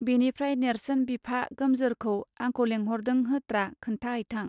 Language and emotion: Bodo, neutral